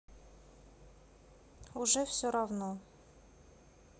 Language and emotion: Russian, sad